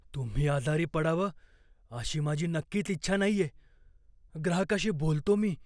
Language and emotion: Marathi, fearful